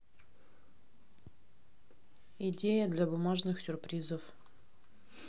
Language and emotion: Russian, neutral